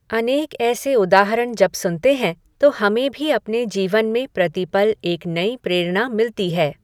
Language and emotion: Hindi, neutral